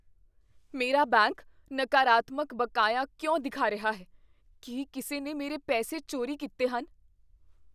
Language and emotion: Punjabi, fearful